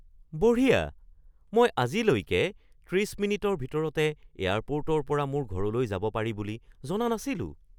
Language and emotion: Assamese, surprised